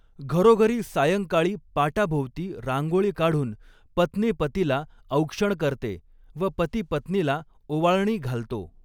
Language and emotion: Marathi, neutral